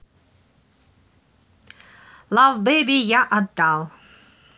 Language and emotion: Russian, neutral